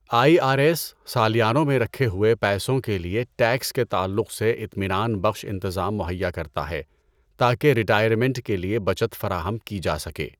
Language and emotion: Urdu, neutral